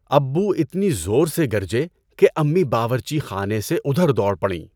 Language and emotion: Urdu, neutral